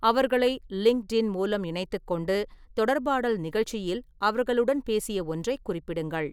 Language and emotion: Tamil, neutral